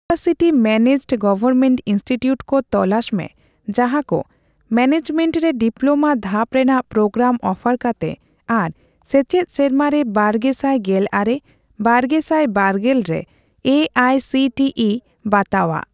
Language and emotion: Santali, neutral